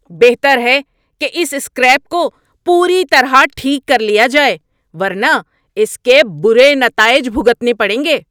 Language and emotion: Urdu, angry